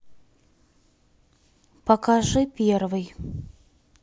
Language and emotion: Russian, neutral